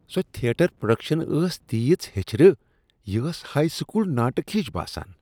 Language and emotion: Kashmiri, disgusted